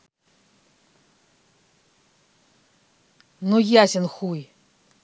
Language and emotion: Russian, angry